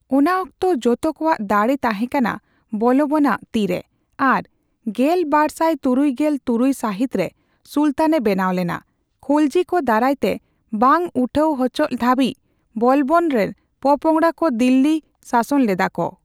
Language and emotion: Santali, neutral